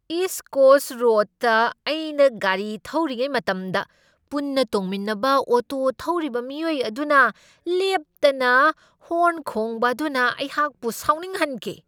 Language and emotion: Manipuri, angry